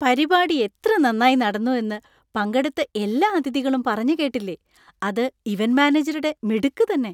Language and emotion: Malayalam, happy